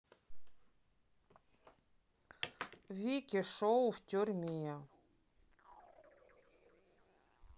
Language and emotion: Russian, neutral